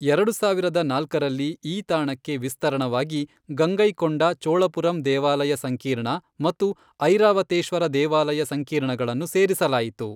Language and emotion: Kannada, neutral